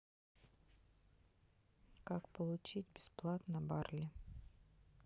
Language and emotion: Russian, neutral